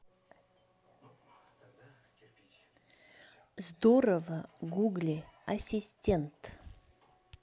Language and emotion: Russian, neutral